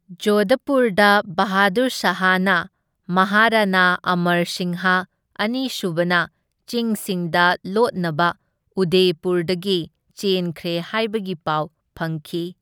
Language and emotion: Manipuri, neutral